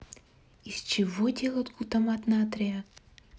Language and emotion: Russian, neutral